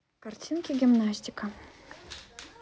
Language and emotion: Russian, neutral